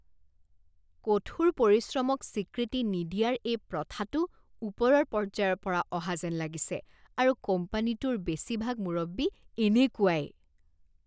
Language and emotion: Assamese, disgusted